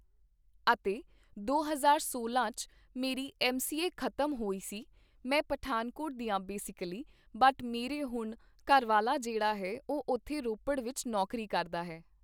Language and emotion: Punjabi, neutral